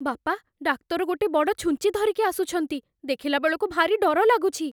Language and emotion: Odia, fearful